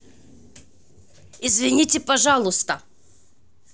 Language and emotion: Russian, angry